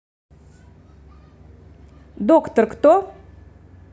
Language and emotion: Russian, neutral